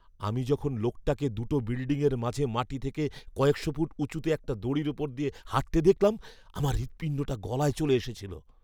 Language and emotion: Bengali, fearful